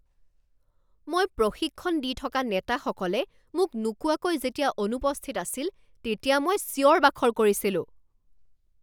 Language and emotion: Assamese, angry